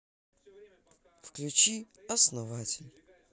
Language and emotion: Russian, sad